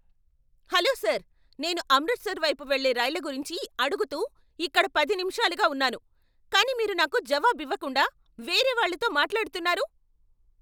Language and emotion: Telugu, angry